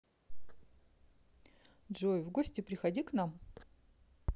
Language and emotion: Russian, neutral